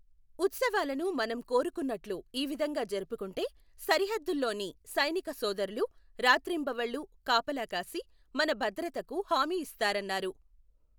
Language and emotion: Telugu, neutral